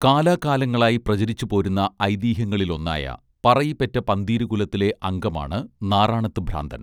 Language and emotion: Malayalam, neutral